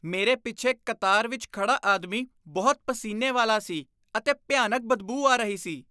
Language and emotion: Punjabi, disgusted